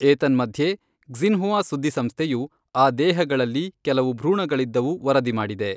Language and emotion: Kannada, neutral